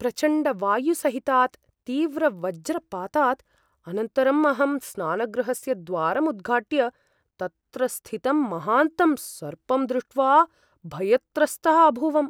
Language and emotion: Sanskrit, fearful